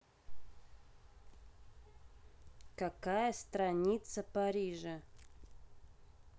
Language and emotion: Russian, neutral